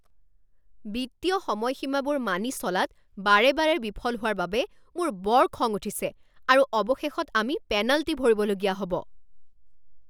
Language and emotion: Assamese, angry